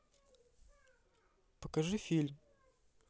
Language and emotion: Russian, neutral